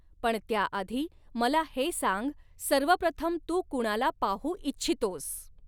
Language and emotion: Marathi, neutral